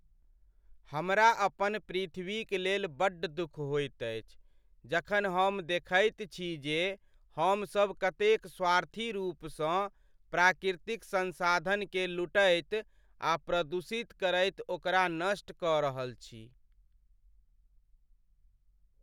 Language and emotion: Maithili, sad